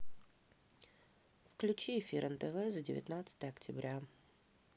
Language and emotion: Russian, neutral